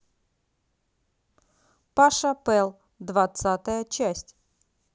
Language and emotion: Russian, positive